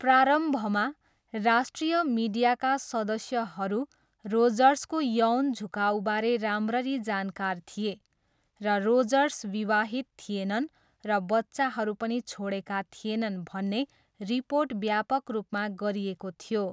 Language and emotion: Nepali, neutral